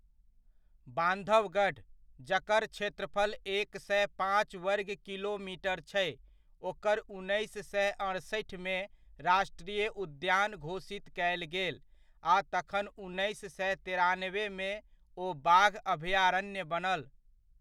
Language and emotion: Maithili, neutral